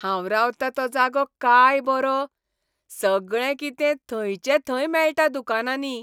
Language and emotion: Goan Konkani, happy